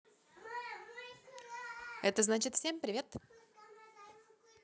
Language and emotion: Russian, positive